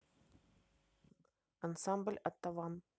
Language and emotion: Russian, neutral